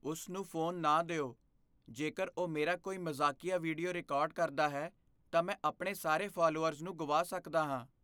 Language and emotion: Punjabi, fearful